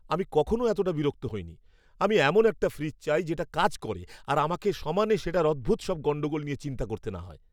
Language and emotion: Bengali, angry